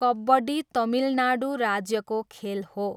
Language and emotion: Nepali, neutral